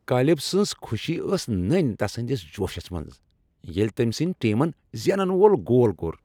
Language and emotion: Kashmiri, happy